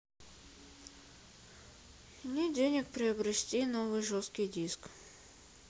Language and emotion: Russian, sad